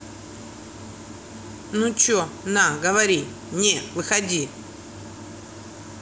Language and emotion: Russian, angry